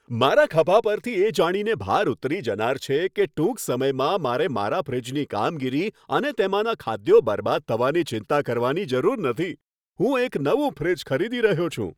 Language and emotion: Gujarati, happy